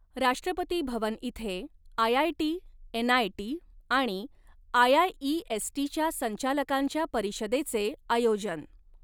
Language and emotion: Marathi, neutral